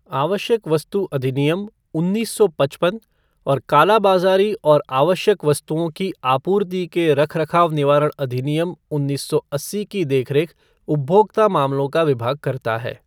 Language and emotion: Hindi, neutral